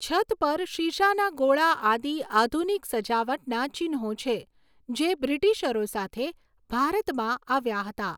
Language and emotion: Gujarati, neutral